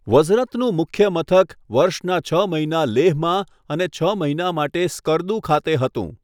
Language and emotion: Gujarati, neutral